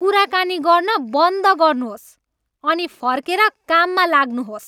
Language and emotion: Nepali, angry